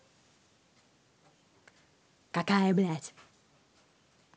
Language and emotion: Russian, angry